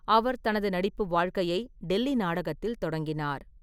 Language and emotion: Tamil, neutral